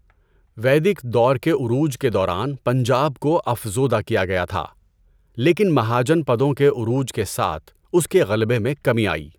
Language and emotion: Urdu, neutral